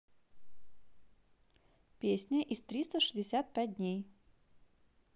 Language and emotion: Russian, neutral